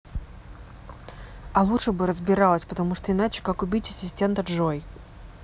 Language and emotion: Russian, angry